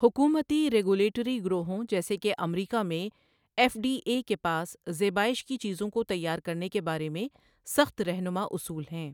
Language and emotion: Urdu, neutral